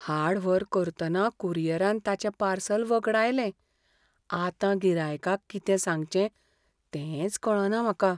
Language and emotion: Goan Konkani, fearful